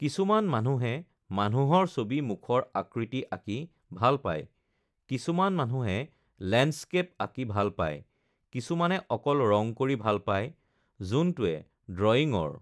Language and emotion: Assamese, neutral